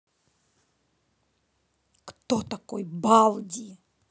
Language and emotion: Russian, angry